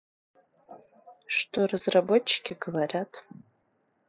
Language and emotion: Russian, neutral